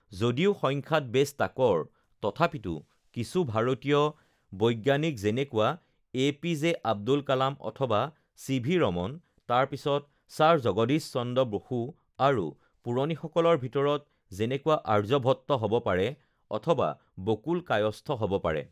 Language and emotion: Assamese, neutral